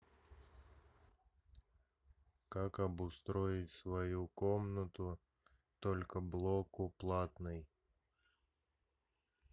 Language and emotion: Russian, neutral